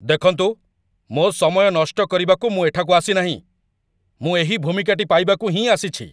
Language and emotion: Odia, angry